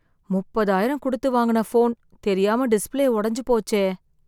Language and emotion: Tamil, sad